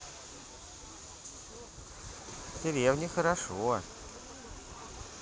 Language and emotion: Russian, positive